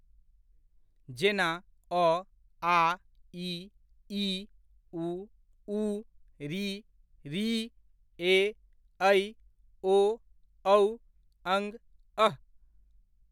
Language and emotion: Maithili, neutral